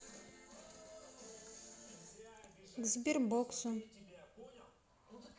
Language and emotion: Russian, neutral